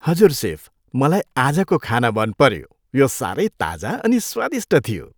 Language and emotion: Nepali, happy